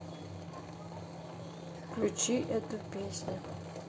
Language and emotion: Russian, neutral